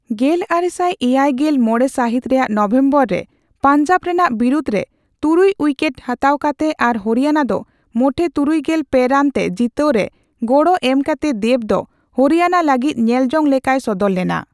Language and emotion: Santali, neutral